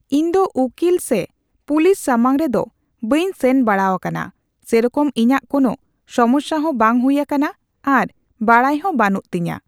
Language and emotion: Santali, neutral